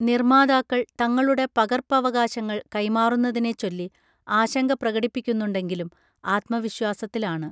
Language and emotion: Malayalam, neutral